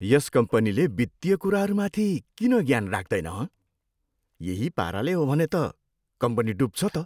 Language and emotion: Nepali, disgusted